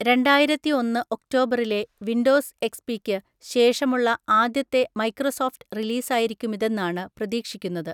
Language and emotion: Malayalam, neutral